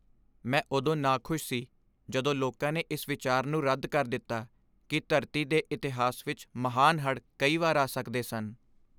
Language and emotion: Punjabi, sad